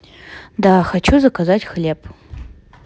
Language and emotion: Russian, neutral